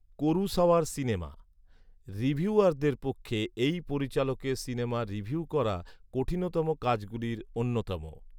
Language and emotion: Bengali, neutral